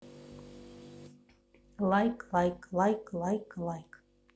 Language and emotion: Russian, neutral